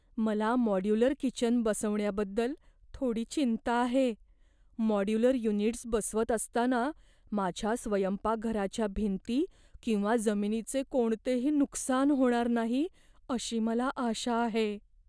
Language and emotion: Marathi, fearful